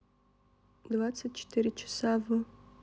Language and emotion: Russian, neutral